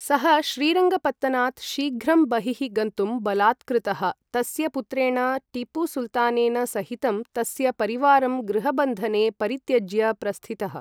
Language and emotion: Sanskrit, neutral